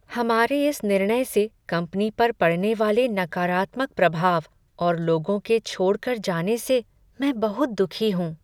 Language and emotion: Hindi, sad